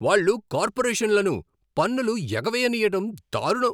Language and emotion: Telugu, angry